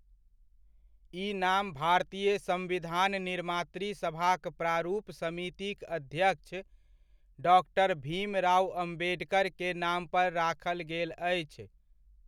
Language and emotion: Maithili, neutral